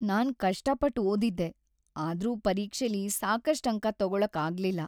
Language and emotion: Kannada, sad